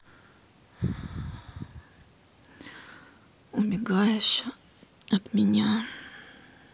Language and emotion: Russian, sad